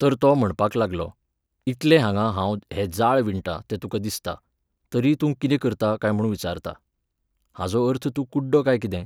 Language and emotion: Goan Konkani, neutral